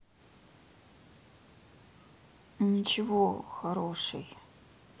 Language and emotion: Russian, sad